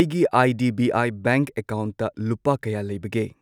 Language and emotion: Manipuri, neutral